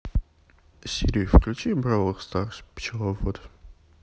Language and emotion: Russian, neutral